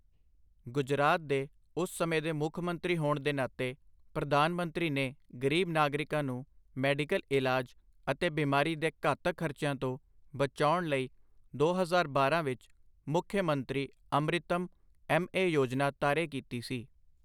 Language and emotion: Punjabi, neutral